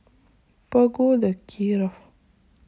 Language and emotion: Russian, sad